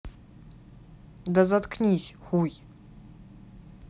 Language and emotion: Russian, angry